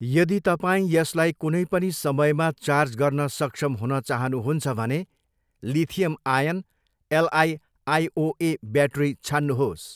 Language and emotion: Nepali, neutral